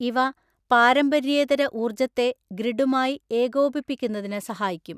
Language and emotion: Malayalam, neutral